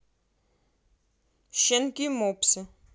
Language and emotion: Russian, neutral